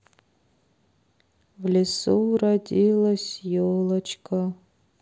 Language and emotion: Russian, sad